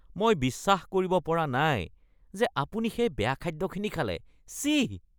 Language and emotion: Assamese, disgusted